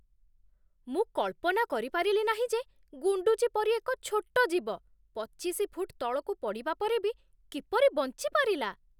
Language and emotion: Odia, surprised